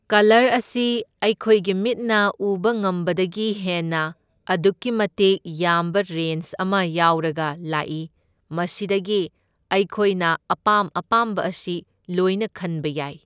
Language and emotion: Manipuri, neutral